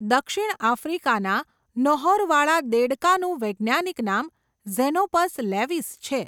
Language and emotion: Gujarati, neutral